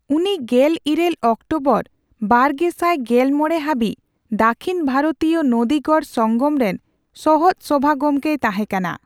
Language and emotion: Santali, neutral